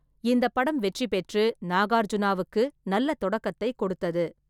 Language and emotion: Tamil, neutral